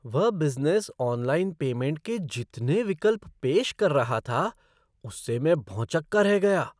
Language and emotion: Hindi, surprised